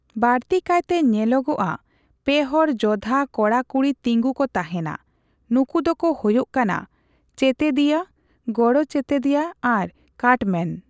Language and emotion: Santali, neutral